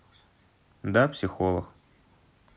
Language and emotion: Russian, neutral